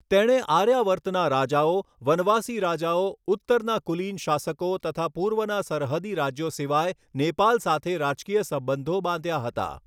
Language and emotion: Gujarati, neutral